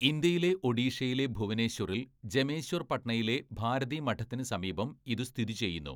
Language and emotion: Malayalam, neutral